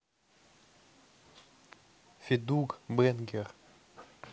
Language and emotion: Russian, neutral